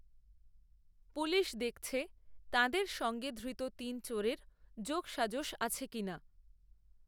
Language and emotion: Bengali, neutral